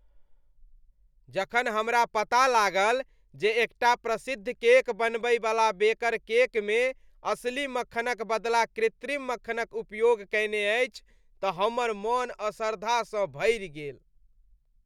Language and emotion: Maithili, disgusted